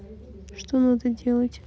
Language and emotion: Russian, neutral